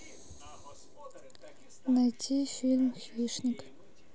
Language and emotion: Russian, neutral